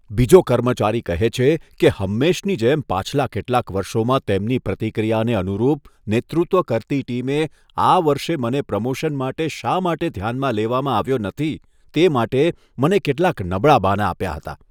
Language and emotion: Gujarati, disgusted